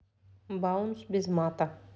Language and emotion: Russian, neutral